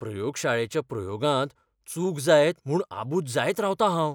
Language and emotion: Goan Konkani, fearful